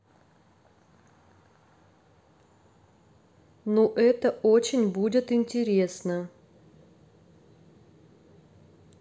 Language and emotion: Russian, neutral